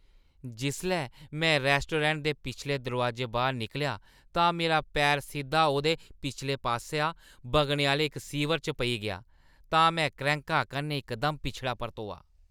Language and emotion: Dogri, disgusted